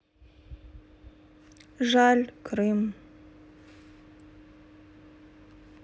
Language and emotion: Russian, sad